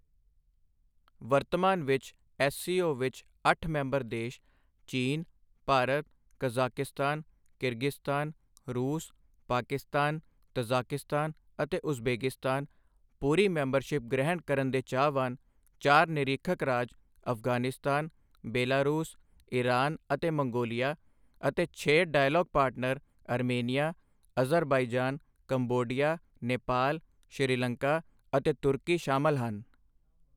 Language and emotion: Punjabi, neutral